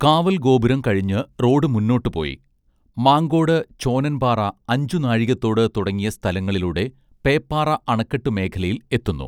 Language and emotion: Malayalam, neutral